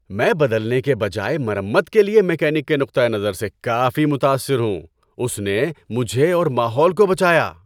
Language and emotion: Urdu, happy